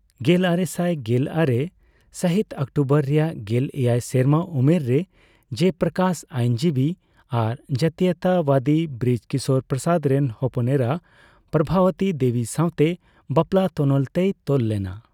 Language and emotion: Santali, neutral